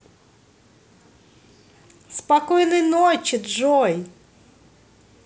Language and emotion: Russian, positive